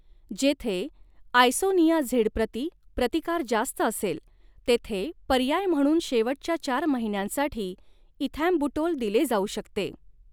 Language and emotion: Marathi, neutral